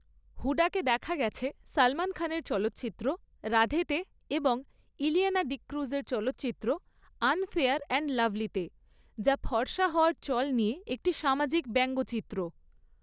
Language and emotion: Bengali, neutral